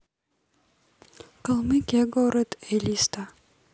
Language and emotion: Russian, neutral